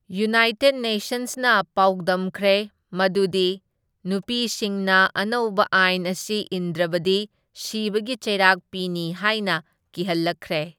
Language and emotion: Manipuri, neutral